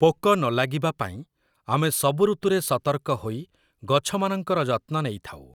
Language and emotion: Odia, neutral